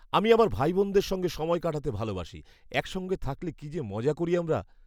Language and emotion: Bengali, happy